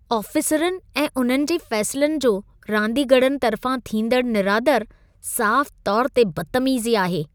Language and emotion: Sindhi, disgusted